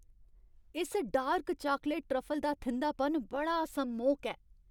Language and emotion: Dogri, happy